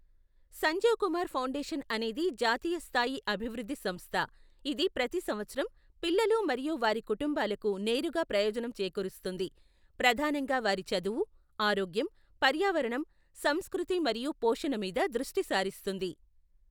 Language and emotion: Telugu, neutral